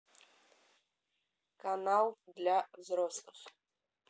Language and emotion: Russian, neutral